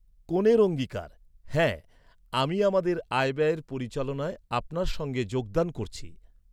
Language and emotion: Bengali, neutral